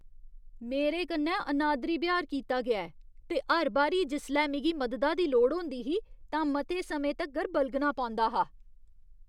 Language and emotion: Dogri, disgusted